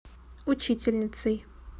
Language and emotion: Russian, neutral